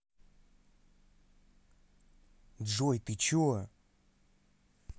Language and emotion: Russian, angry